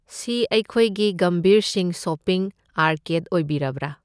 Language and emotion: Manipuri, neutral